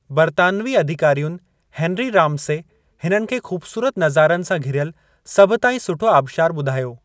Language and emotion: Sindhi, neutral